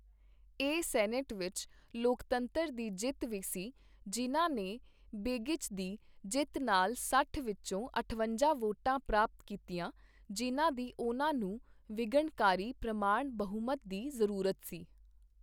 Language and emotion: Punjabi, neutral